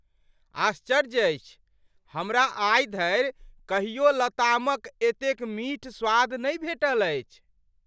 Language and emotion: Maithili, surprised